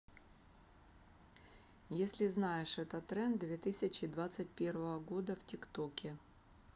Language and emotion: Russian, neutral